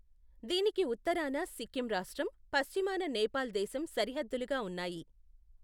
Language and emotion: Telugu, neutral